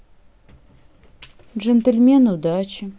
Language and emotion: Russian, neutral